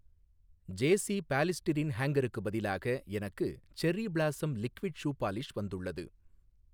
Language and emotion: Tamil, neutral